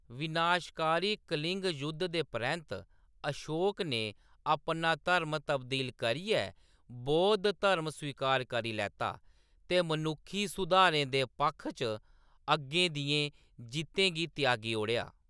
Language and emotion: Dogri, neutral